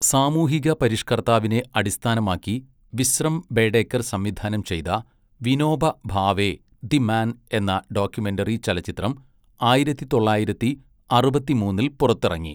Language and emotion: Malayalam, neutral